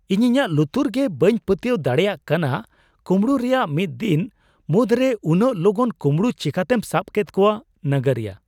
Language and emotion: Santali, surprised